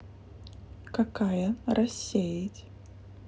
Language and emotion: Russian, neutral